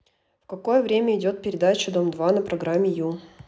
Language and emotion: Russian, neutral